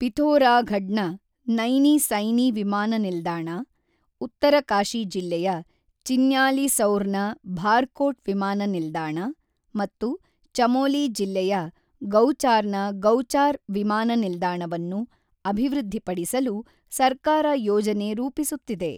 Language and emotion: Kannada, neutral